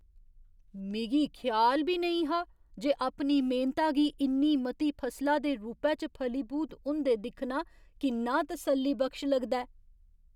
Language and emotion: Dogri, surprised